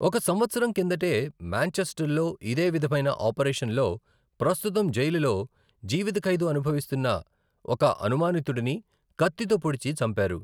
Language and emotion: Telugu, neutral